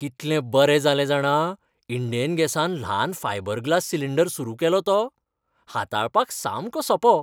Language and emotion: Goan Konkani, happy